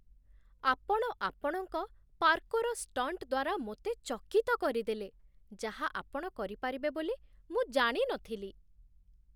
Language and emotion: Odia, surprised